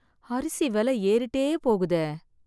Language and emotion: Tamil, sad